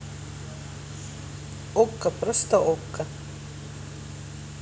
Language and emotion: Russian, neutral